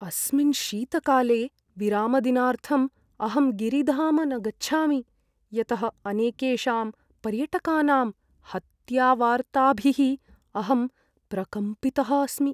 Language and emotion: Sanskrit, fearful